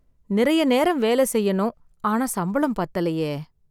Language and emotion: Tamil, sad